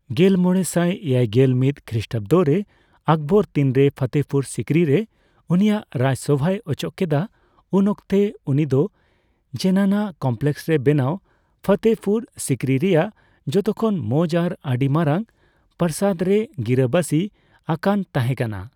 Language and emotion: Santali, neutral